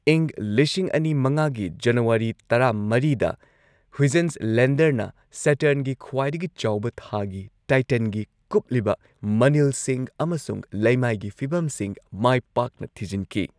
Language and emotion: Manipuri, neutral